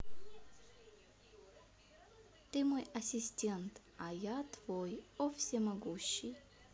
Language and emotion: Russian, neutral